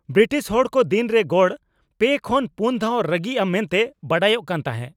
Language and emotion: Santali, angry